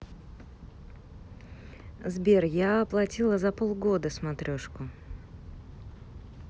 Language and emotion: Russian, neutral